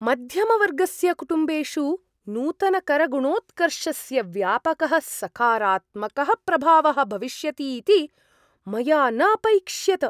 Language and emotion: Sanskrit, surprised